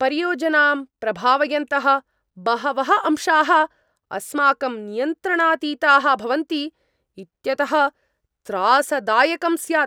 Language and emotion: Sanskrit, angry